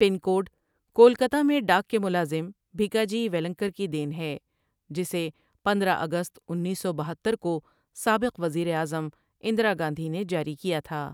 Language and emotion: Urdu, neutral